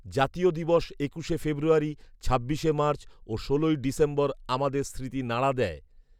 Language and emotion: Bengali, neutral